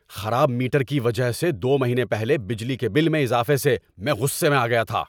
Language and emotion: Urdu, angry